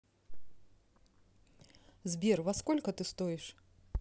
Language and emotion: Russian, neutral